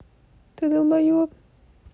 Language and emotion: Russian, angry